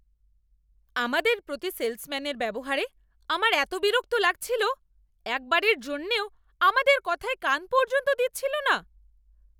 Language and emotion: Bengali, angry